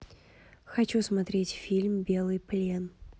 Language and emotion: Russian, neutral